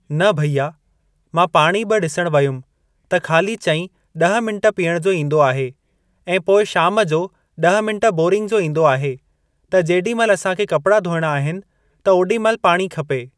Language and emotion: Sindhi, neutral